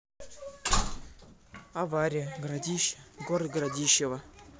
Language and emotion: Russian, neutral